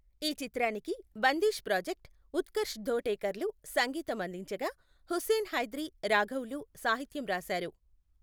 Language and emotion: Telugu, neutral